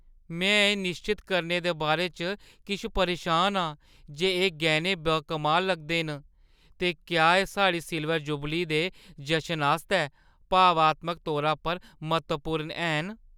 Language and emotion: Dogri, fearful